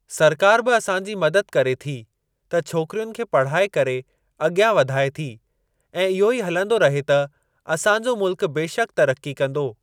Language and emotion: Sindhi, neutral